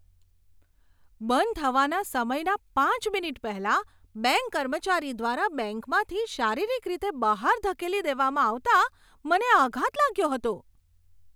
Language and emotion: Gujarati, surprised